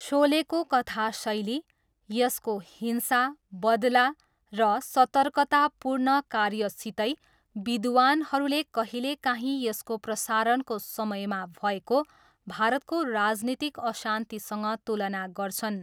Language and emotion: Nepali, neutral